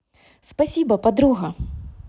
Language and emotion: Russian, positive